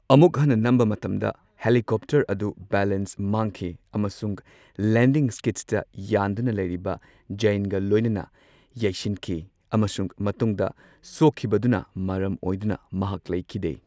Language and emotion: Manipuri, neutral